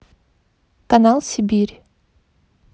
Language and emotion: Russian, neutral